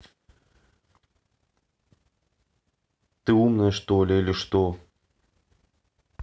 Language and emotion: Russian, neutral